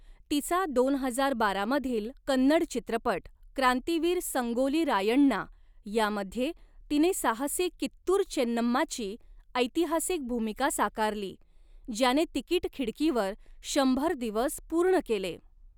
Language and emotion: Marathi, neutral